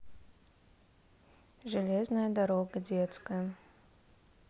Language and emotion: Russian, neutral